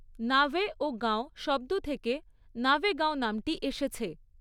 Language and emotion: Bengali, neutral